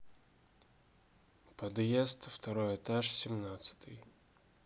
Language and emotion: Russian, neutral